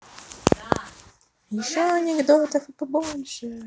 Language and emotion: Russian, positive